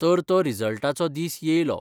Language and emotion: Goan Konkani, neutral